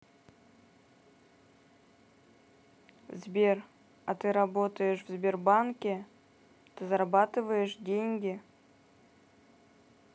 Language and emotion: Russian, neutral